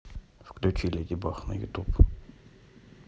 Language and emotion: Russian, neutral